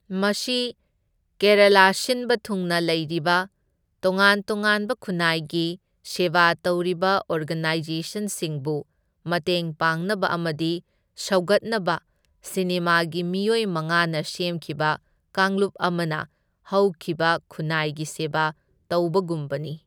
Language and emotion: Manipuri, neutral